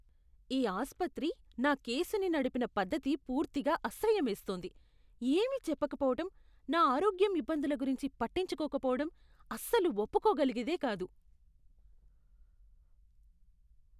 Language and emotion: Telugu, disgusted